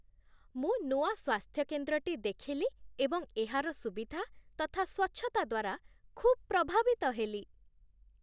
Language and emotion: Odia, happy